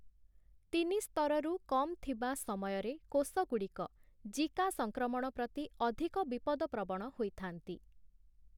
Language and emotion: Odia, neutral